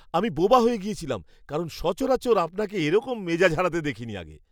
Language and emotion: Bengali, surprised